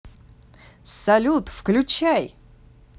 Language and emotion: Russian, positive